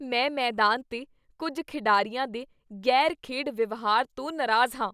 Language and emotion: Punjabi, disgusted